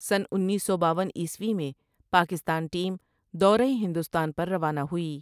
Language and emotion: Urdu, neutral